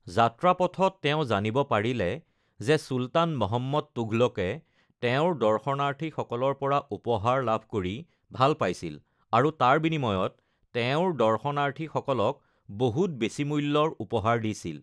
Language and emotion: Assamese, neutral